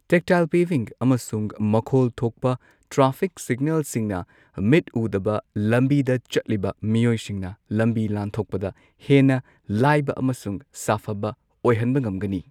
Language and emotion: Manipuri, neutral